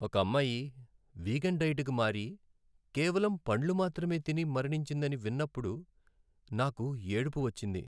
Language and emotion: Telugu, sad